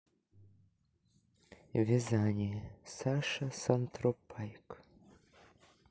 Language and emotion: Russian, neutral